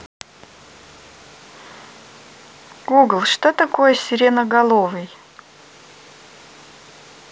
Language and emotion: Russian, neutral